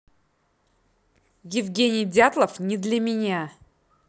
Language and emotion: Russian, angry